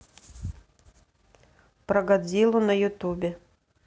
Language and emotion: Russian, neutral